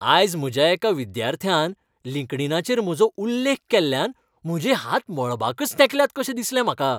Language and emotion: Goan Konkani, happy